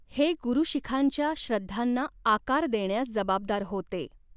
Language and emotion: Marathi, neutral